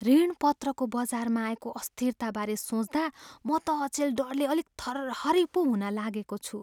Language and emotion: Nepali, fearful